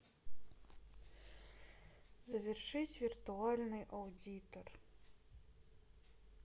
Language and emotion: Russian, sad